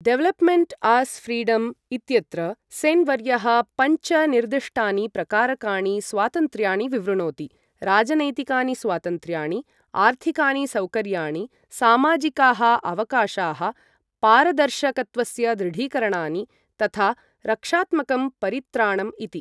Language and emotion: Sanskrit, neutral